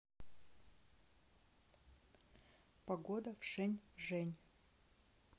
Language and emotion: Russian, neutral